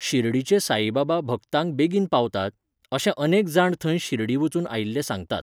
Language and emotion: Goan Konkani, neutral